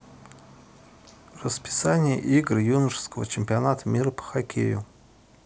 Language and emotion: Russian, neutral